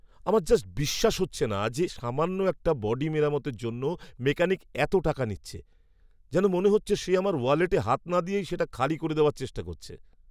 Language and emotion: Bengali, angry